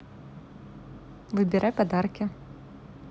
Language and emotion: Russian, neutral